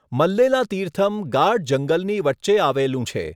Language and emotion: Gujarati, neutral